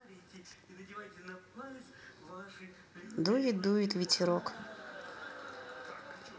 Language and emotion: Russian, neutral